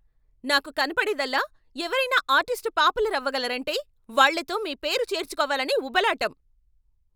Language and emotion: Telugu, angry